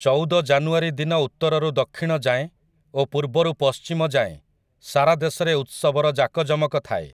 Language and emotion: Odia, neutral